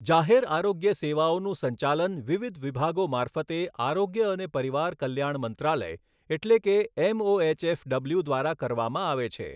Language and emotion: Gujarati, neutral